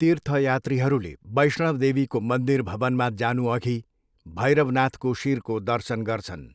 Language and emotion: Nepali, neutral